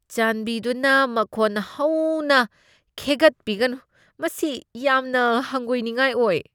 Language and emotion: Manipuri, disgusted